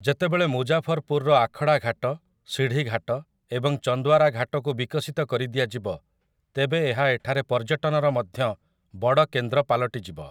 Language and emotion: Odia, neutral